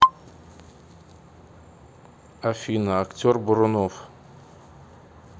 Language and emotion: Russian, neutral